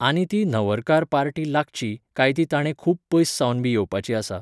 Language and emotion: Goan Konkani, neutral